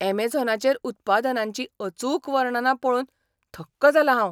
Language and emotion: Goan Konkani, surprised